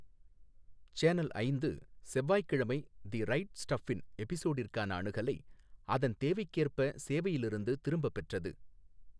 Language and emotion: Tamil, neutral